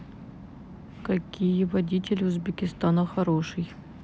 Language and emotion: Russian, neutral